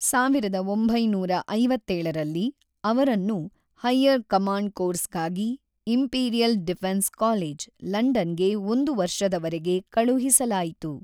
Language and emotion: Kannada, neutral